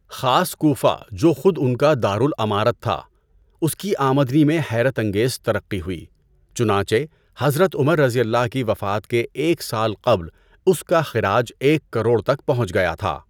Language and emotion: Urdu, neutral